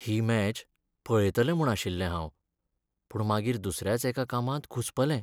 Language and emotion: Goan Konkani, sad